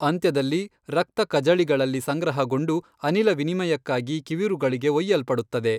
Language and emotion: Kannada, neutral